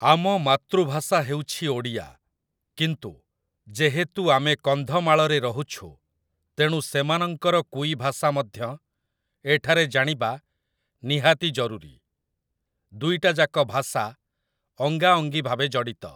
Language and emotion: Odia, neutral